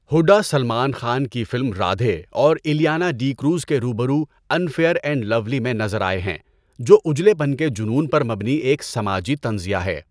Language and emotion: Urdu, neutral